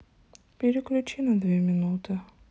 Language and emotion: Russian, sad